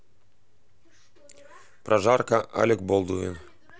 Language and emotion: Russian, neutral